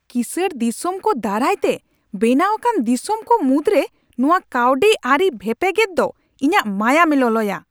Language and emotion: Santali, angry